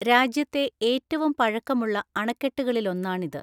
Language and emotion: Malayalam, neutral